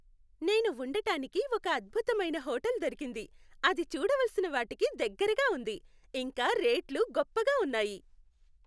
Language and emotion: Telugu, happy